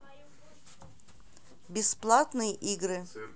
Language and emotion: Russian, neutral